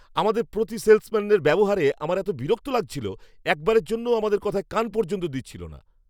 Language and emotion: Bengali, angry